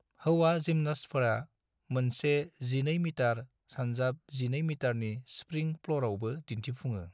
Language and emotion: Bodo, neutral